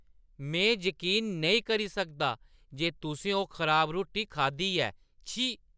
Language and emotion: Dogri, disgusted